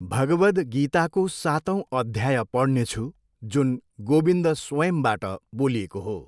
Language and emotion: Nepali, neutral